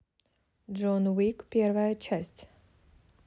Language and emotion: Russian, neutral